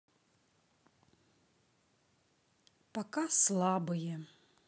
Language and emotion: Russian, sad